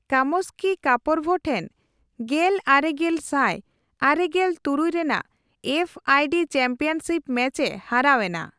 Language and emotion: Santali, neutral